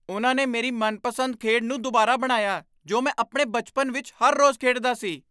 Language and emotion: Punjabi, surprised